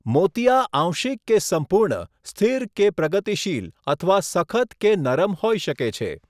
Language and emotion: Gujarati, neutral